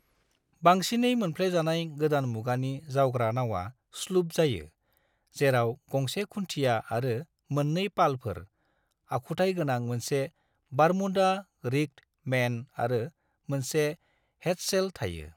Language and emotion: Bodo, neutral